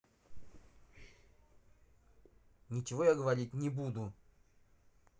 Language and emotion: Russian, angry